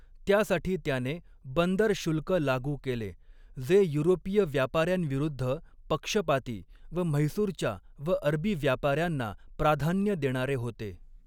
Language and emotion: Marathi, neutral